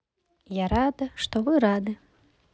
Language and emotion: Russian, positive